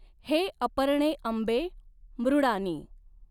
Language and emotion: Marathi, neutral